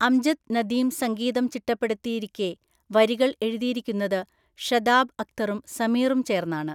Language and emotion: Malayalam, neutral